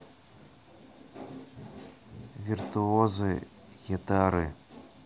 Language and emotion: Russian, neutral